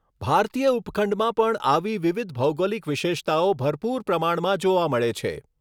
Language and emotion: Gujarati, neutral